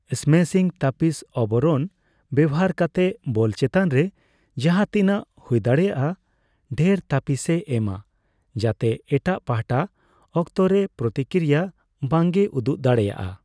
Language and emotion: Santali, neutral